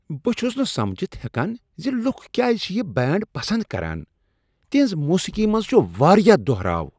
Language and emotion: Kashmiri, disgusted